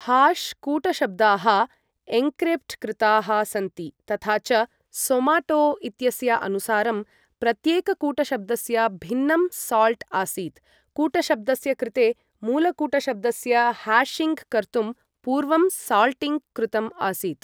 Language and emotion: Sanskrit, neutral